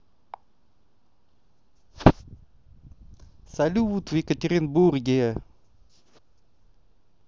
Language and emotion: Russian, positive